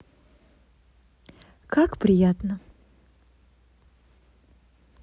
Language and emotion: Russian, neutral